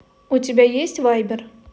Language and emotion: Russian, neutral